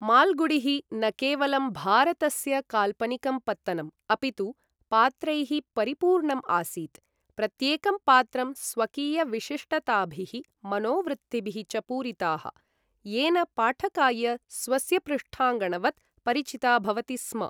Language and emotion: Sanskrit, neutral